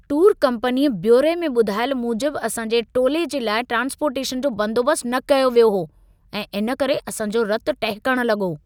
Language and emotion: Sindhi, angry